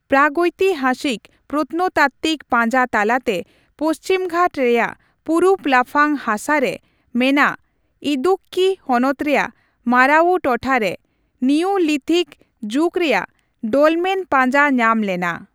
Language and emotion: Santali, neutral